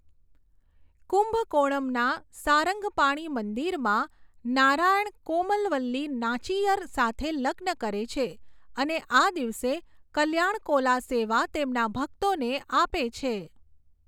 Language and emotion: Gujarati, neutral